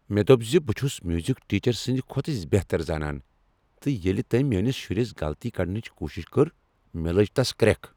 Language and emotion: Kashmiri, angry